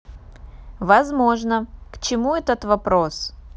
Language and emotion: Russian, neutral